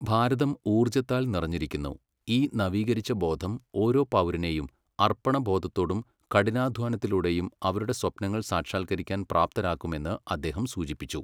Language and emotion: Malayalam, neutral